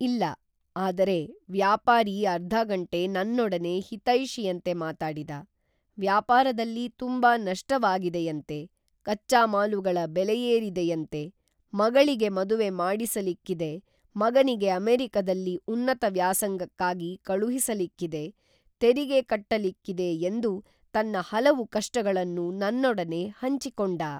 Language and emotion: Kannada, neutral